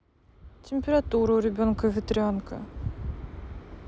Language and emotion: Russian, sad